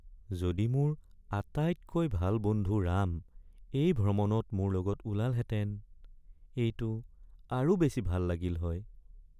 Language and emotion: Assamese, sad